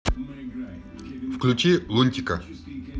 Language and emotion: Russian, neutral